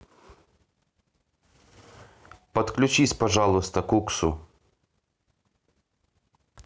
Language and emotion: Russian, neutral